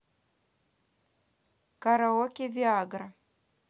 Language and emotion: Russian, neutral